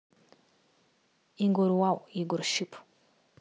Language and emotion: Russian, neutral